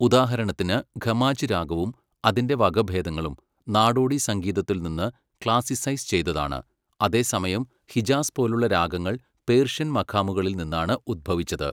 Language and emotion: Malayalam, neutral